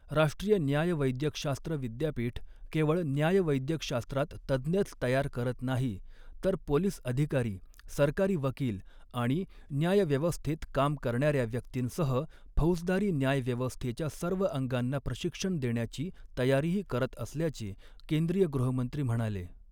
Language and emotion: Marathi, neutral